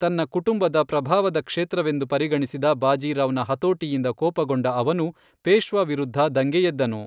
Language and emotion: Kannada, neutral